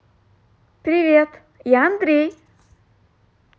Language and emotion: Russian, positive